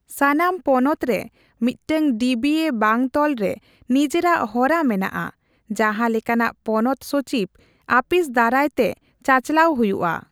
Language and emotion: Santali, neutral